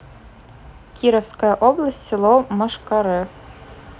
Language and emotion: Russian, neutral